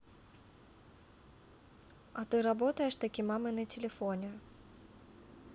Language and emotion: Russian, neutral